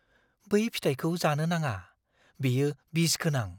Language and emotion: Bodo, fearful